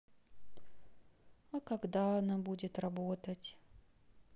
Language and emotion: Russian, sad